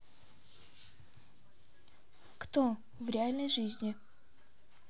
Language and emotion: Russian, neutral